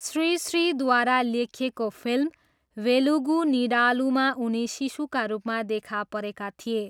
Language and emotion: Nepali, neutral